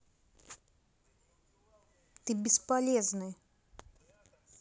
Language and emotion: Russian, angry